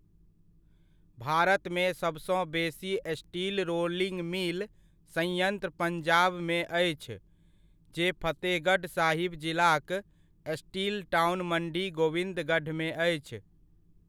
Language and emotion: Maithili, neutral